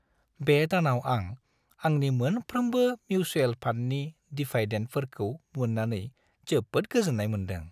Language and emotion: Bodo, happy